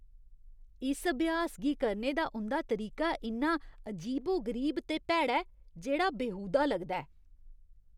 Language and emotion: Dogri, disgusted